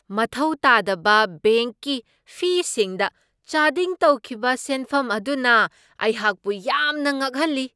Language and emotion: Manipuri, surprised